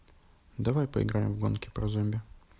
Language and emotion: Russian, neutral